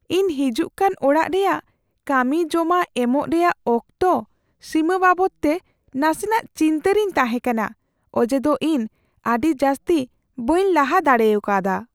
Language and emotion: Santali, fearful